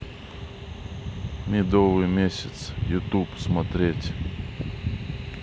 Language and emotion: Russian, neutral